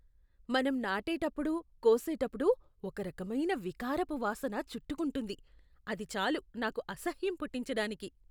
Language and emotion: Telugu, disgusted